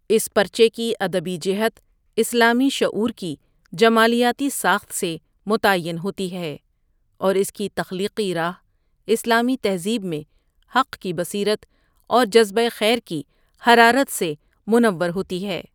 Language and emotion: Urdu, neutral